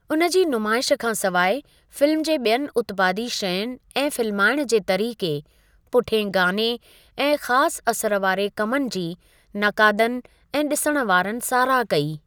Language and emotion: Sindhi, neutral